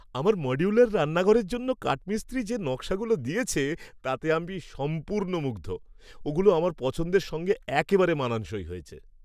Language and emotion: Bengali, happy